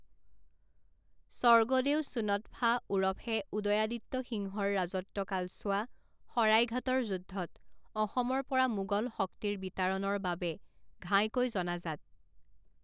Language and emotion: Assamese, neutral